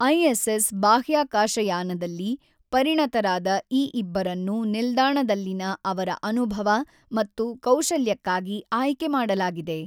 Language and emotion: Kannada, neutral